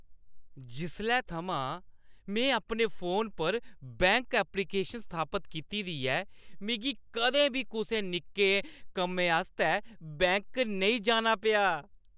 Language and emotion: Dogri, happy